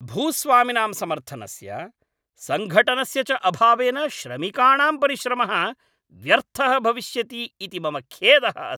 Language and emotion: Sanskrit, angry